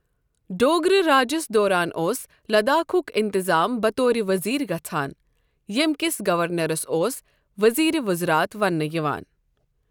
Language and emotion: Kashmiri, neutral